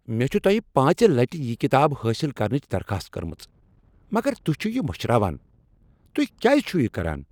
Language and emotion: Kashmiri, angry